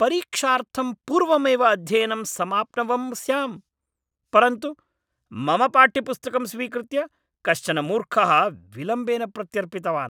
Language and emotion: Sanskrit, angry